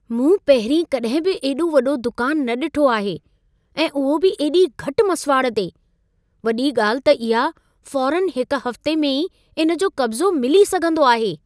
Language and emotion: Sindhi, surprised